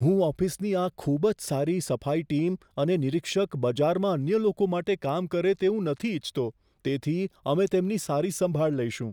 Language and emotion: Gujarati, fearful